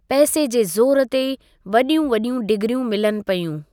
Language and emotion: Sindhi, neutral